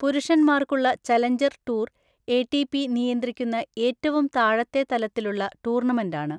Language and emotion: Malayalam, neutral